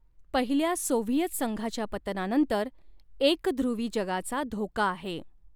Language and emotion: Marathi, neutral